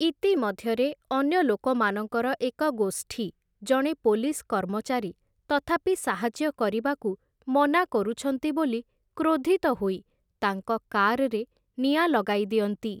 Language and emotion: Odia, neutral